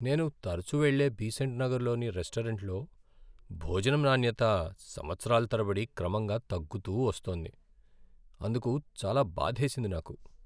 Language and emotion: Telugu, sad